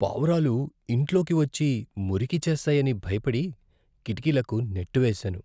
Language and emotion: Telugu, fearful